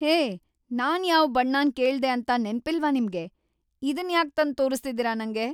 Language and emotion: Kannada, angry